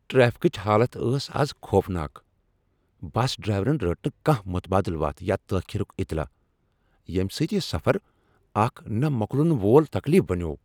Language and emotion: Kashmiri, angry